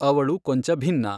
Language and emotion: Kannada, neutral